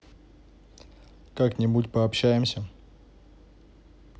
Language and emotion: Russian, neutral